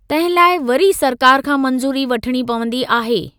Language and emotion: Sindhi, neutral